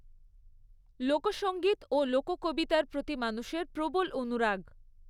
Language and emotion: Bengali, neutral